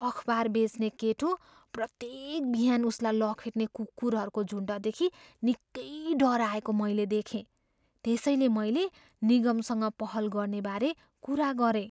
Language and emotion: Nepali, fearful